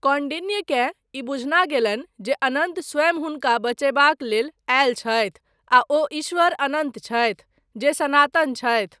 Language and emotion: Maithili, neutral